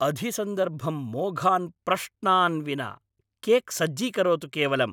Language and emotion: Sanskrit, angry